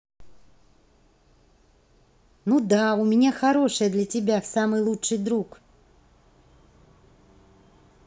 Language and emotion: Russian, positive